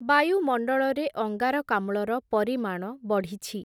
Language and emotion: Odia, neutral